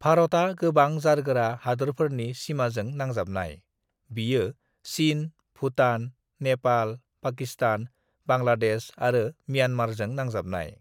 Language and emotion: Bodo, neutral